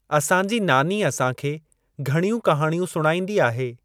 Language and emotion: Sindhi, neutral